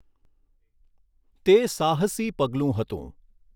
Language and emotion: Gujarati, neutral